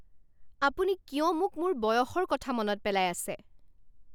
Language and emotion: Assamese, angry